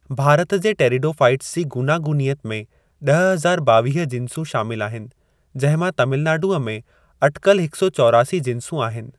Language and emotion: Sindhi, neutral